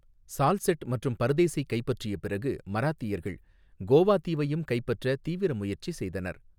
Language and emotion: Tamil, neutral